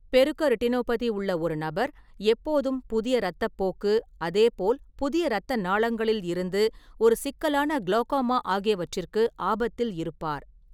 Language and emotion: Tamil, neutral